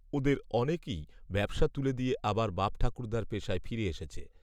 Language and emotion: Bengali, neutral